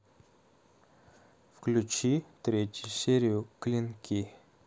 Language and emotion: Russian, neutral